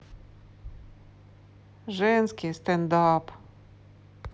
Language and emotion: Russian, neutral